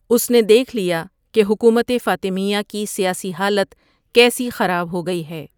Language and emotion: Urdu, neutral